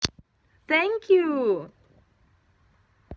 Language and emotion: Russian, positive